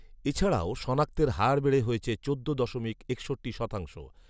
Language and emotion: Bengali, neutral